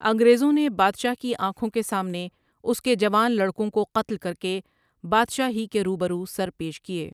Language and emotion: Urdu, neutral